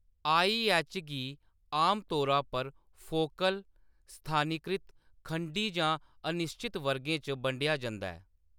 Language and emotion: Dogri, neutral